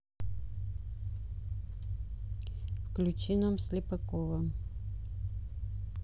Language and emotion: Russian, neutral